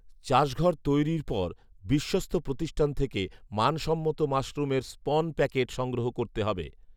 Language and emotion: Bengali, neutral